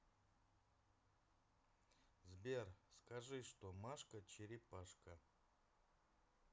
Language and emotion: Russian, neutral